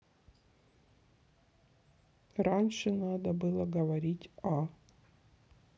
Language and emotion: Russian, sad